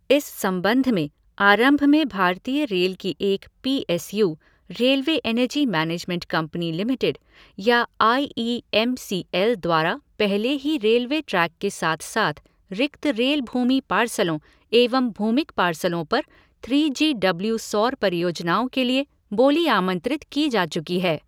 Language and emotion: Hindi, neutral